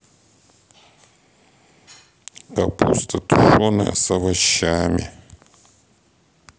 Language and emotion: Russian, sad